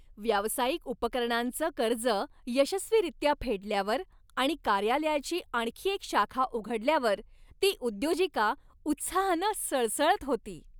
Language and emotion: Marathi, happy